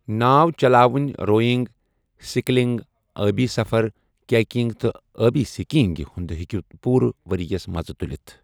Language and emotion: Kashmiri, neutral